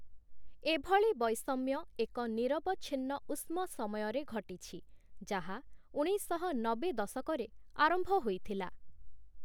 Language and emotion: Odia, neutral